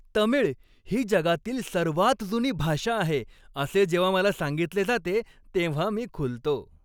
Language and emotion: Marathi, happy